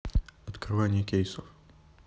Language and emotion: Russian, neutral